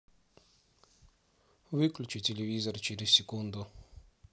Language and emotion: Russian, neutral